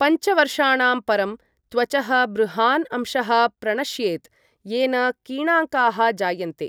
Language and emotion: Sanskrit, neutral